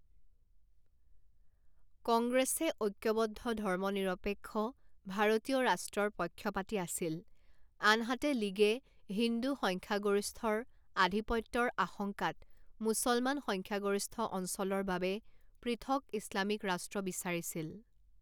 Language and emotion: Assamese, neutral